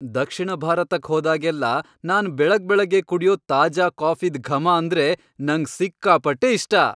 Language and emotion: Kannada, happy